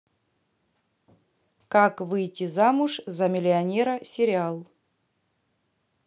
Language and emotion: Russian, neutral